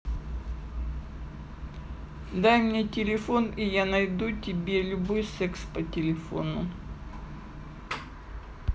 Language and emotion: Russian, neutral